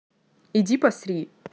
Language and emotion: Russian, neutral